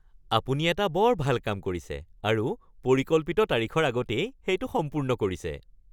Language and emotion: Assamese, happy